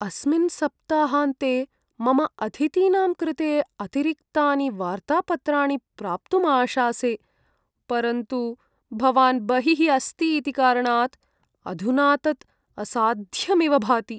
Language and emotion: Sanskrit, sad